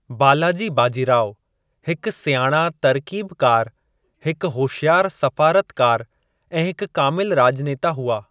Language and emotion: Sindhi, neutral